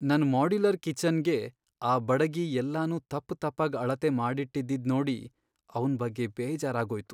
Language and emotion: Kannada, sad